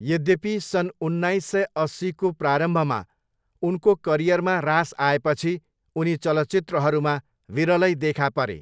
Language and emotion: Nepali, neutral